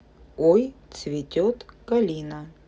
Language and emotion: Russian, neutral